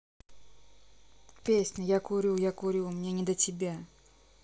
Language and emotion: Russian, neutral